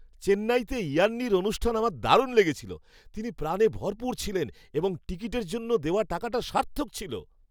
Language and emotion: Bengali, happy